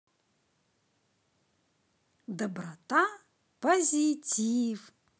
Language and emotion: Russian, positive